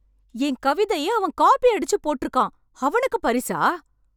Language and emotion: Tamil, angry